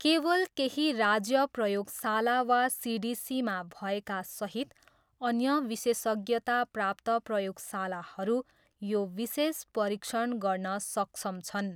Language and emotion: Nepali, neutral